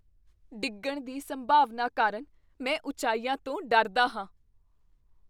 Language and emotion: Punjabi, fearful